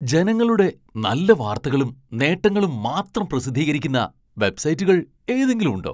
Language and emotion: Malayalam, surprised